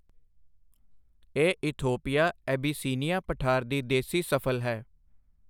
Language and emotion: Punjabi, neutral